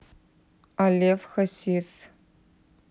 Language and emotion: Russian, neutral